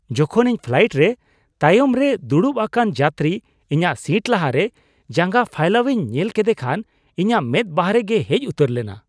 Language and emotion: Santali, surprised